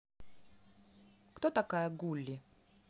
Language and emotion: Russian, neutral